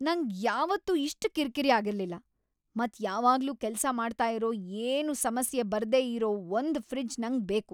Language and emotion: Kannada, angry